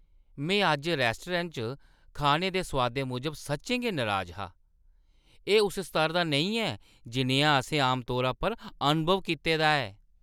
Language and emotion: Dogri, disgusted